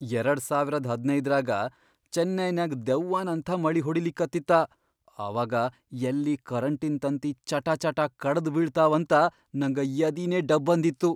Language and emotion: Kannada, fearful